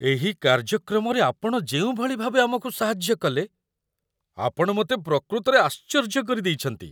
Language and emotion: Odia, surprised